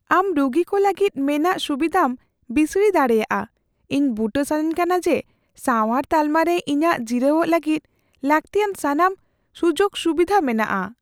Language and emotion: Santali, fearful